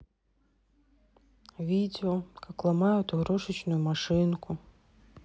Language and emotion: Russian, sad